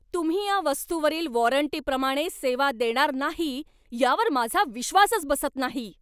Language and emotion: Marathi, angry